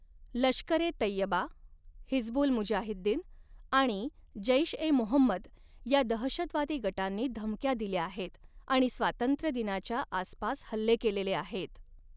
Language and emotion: Marathi, neutral